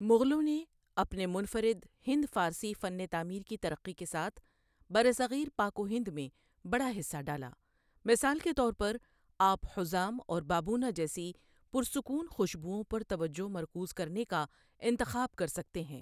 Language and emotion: Urdu, neutral